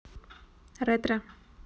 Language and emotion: Russian, neutral